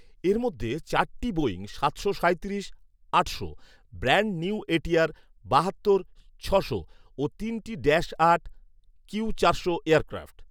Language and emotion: Bengali, neutral